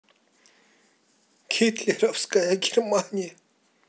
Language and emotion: Russian, sad